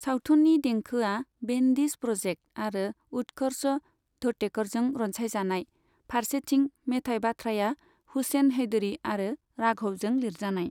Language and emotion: Bodo, neutral